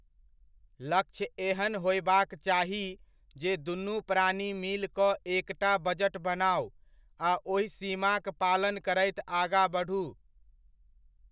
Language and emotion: Maithili, neutral